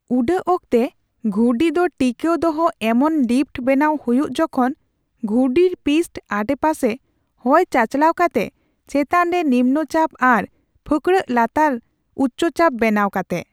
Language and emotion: Santali, neutral